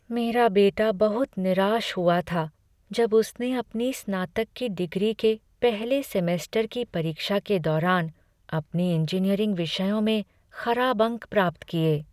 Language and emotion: Hindi, sad